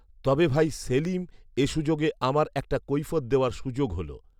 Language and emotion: Bengali, neutral